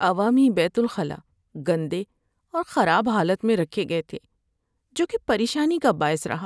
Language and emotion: Urdu, sad